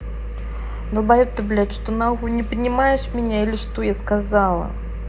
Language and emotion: Russian, angry